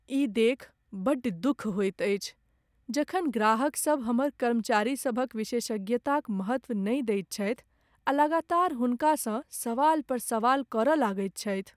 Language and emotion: Maithili, sad